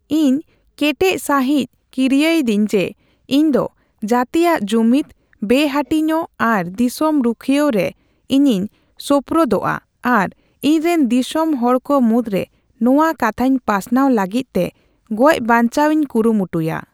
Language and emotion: Santali, neutral